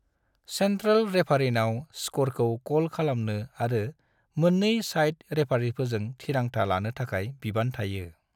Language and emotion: Bodo, neutral